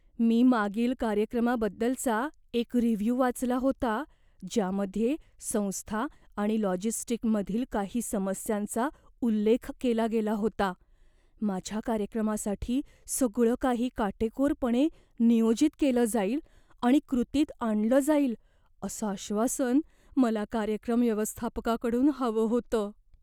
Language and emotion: Marathi, fearful